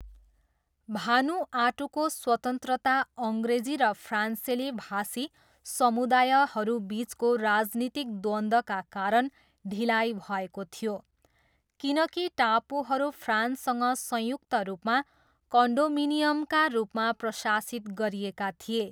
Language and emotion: Nepali, neutral